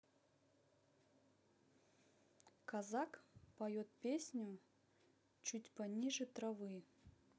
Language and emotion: Russian, neutral